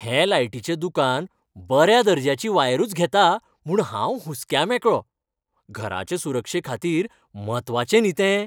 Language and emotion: Goan Konkani, happy